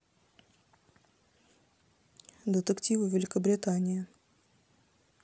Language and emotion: Russian, neutral